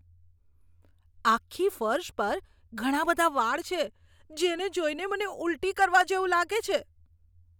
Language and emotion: Gujarati, disgusted